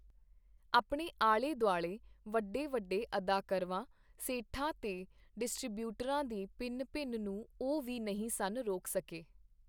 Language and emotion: Punjabi, neutral